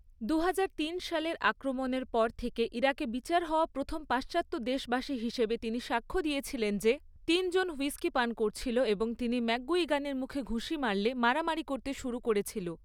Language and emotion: Bengali, neutral